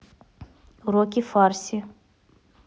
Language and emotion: Russian, neutral